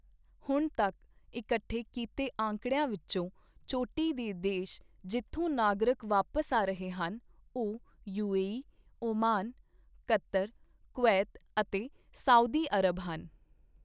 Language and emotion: Punjabi, neutral